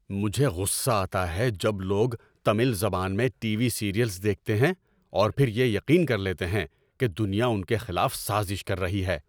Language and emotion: Urdu, angry